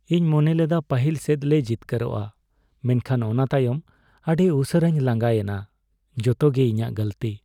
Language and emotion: Santali, sad